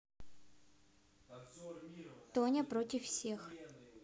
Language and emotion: Russian, neutral